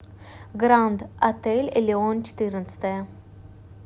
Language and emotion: Russian, neutral